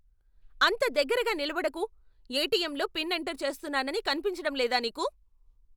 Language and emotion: Telugu, angry